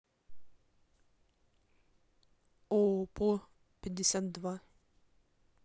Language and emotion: Russian, neutral